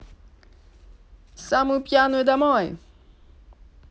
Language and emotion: Russian, neutral